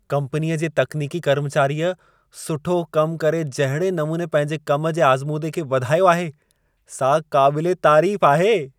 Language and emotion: Sindhi, happy